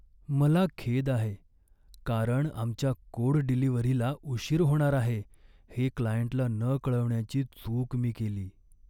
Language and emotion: Marathi, sad